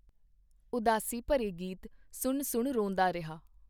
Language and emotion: Punjabi, neutral